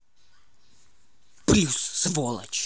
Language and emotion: Russian, angry